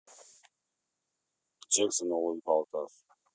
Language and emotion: Russian, neutral